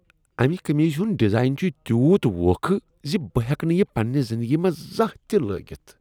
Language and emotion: Kashmiri, disgusted